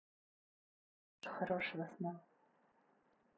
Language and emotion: Russian, neutral